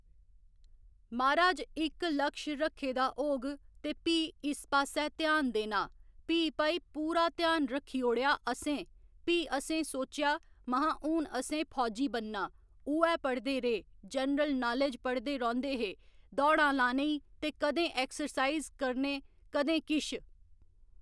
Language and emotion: Dogri, neutral